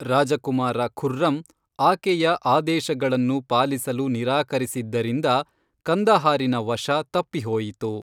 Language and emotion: Kannada, neutral